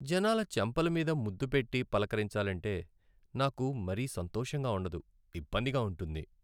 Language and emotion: Telugu, sad